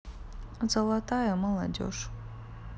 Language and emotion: Russian, neutral